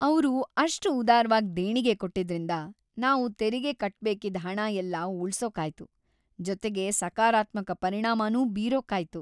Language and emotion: Kannada, happy